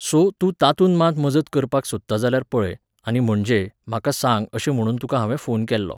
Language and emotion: Goan Konkani, neutral